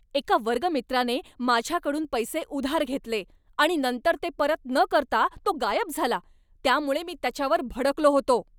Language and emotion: Marathi, angry